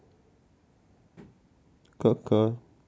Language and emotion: Russian, sad